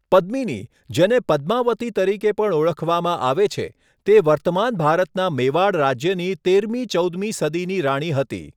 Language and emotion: Gujarati, neutral